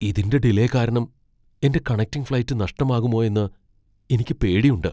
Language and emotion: Malayalam, fearful